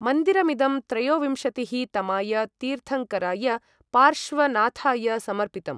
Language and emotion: Sanskrit, neutral